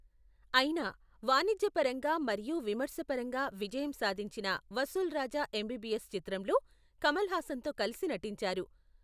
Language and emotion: Telugu, neutral